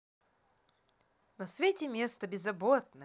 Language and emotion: Russian, positive